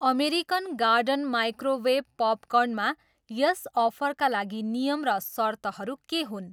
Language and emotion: Nepali, neutral